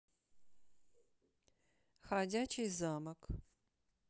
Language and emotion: Russian, neutral